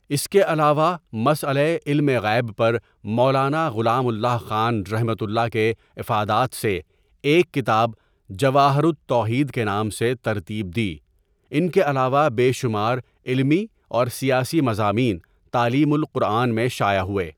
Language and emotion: Urdu, neutral